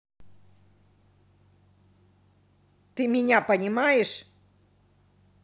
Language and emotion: Russian, angry